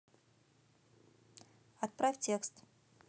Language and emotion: Russian, neutral